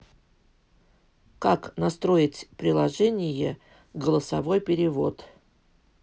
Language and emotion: Russian, neutral